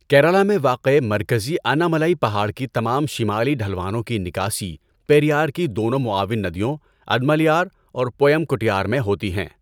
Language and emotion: Urdu, neutral